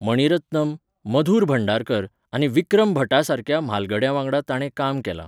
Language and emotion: Goan Konkani, neutral